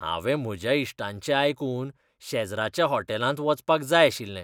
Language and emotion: Goan Konkani, disgusted